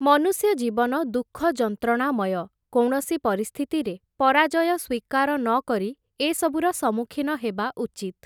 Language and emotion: Odia, neutral